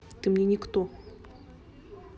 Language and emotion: Russian, neutral